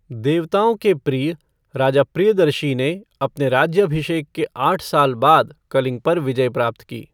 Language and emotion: Hindi, neutral